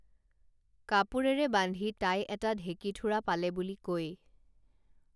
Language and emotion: Assamese, neutral